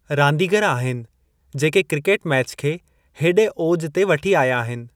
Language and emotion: Sindhi, neutral